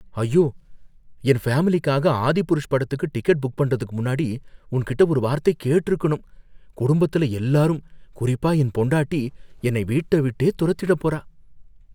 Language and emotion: Tamil, fearful